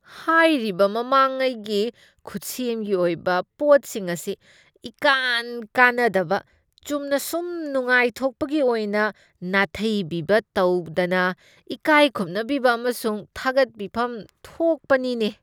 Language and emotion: Manipuri, disgusted